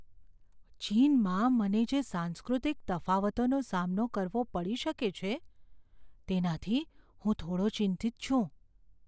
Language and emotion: Gujarati, fearful